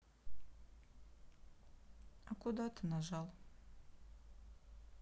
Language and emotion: Russian, sad